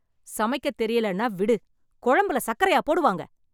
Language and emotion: Tamil, angry